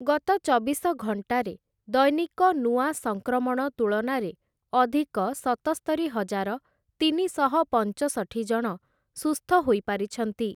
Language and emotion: Odia, neutral